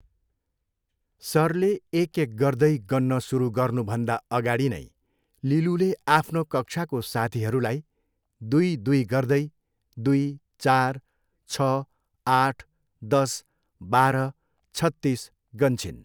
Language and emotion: Nepali, neutral